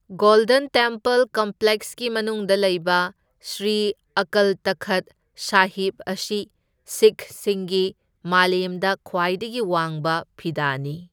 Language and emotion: Manipuri, neutral